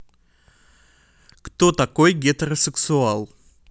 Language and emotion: Russian, neutral